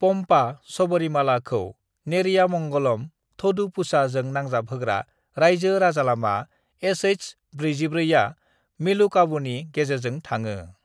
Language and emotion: Bodo, neutral